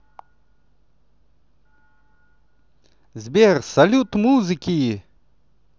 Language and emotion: Russian, positive